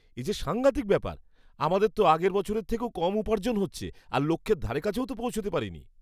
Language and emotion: Bengali, disgusted